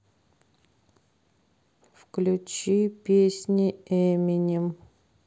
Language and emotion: Russian, neutral